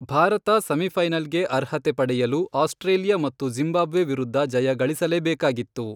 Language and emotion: Kannada, neutral